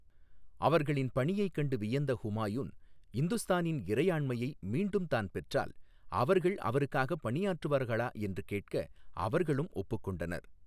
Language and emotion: Tamil, neutral